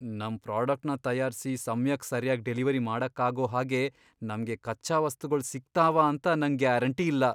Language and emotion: Kannada, fearful